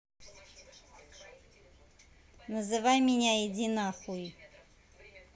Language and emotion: Russian, neutral